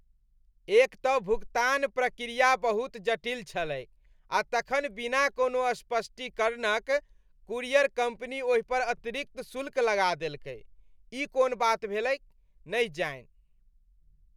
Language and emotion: Maithili, disgusted